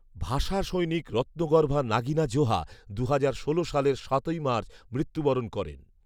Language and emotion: Bengali, neutral